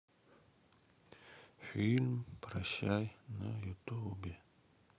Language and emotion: Russian, sad